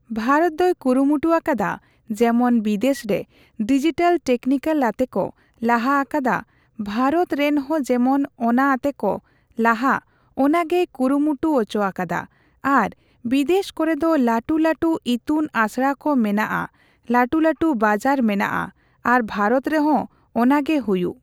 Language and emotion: Santali, neutral